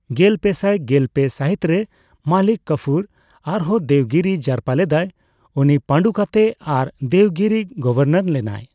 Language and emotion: Santali, neutral